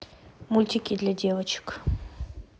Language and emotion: Russian, neutral